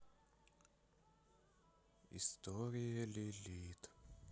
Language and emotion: Russian, sad